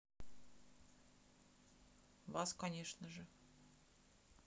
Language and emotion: Russian, neutral